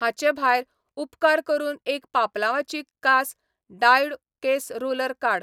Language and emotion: Goan Konkani, neutral